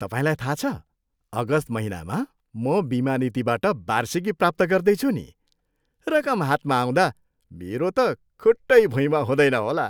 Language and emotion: Nepali, happy